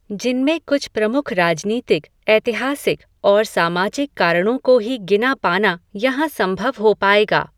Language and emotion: Hindi, neutral